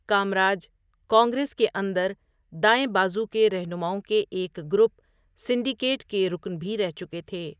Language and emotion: Urdu, neutral